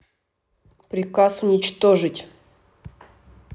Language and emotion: Russian, angry